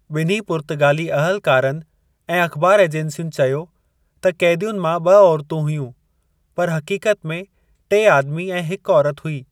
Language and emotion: Sindhi, neutral